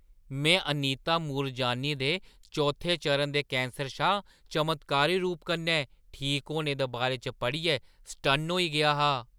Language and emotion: Dogri, surprised